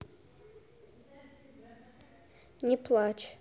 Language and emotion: Russian, neutral